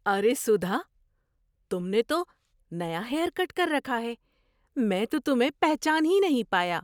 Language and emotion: Urdu, surprised